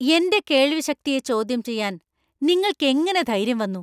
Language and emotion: Malayalam, angry